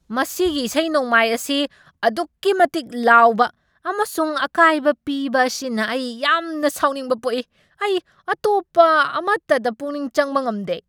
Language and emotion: Manipuri, angry